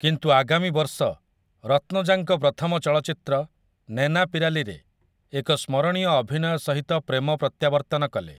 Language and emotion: Odia, neutral